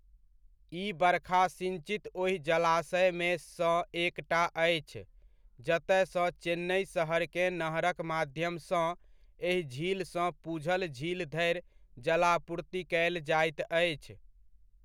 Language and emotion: Maithili, neutral